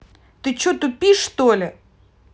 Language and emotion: Russian, angry